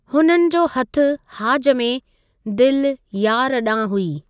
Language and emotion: Sindhi, neutral